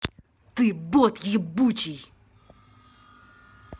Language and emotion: Russian, angry